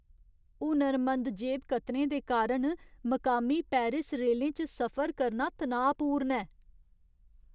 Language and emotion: Dogri, fearful